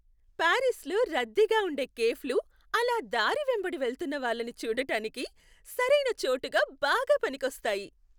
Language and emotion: Telugu, happy